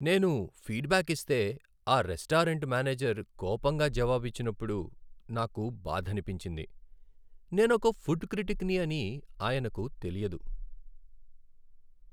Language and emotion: Telugu, sad